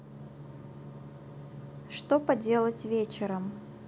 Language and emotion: Russian, neutral